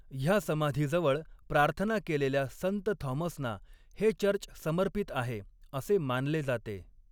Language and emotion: Marathi, neutral